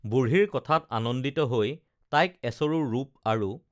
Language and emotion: Assamese, neutral